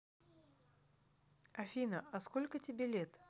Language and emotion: Russian, neutral